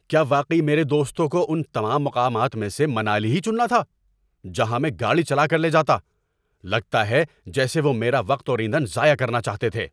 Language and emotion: Urdu, angry